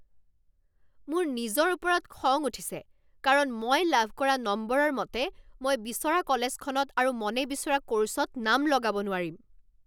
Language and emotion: Assamese, angry